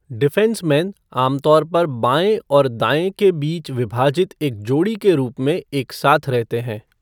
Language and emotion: Hindi, neutral